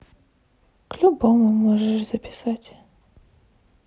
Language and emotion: Russian, sad